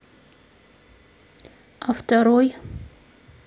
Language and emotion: Russian, neutral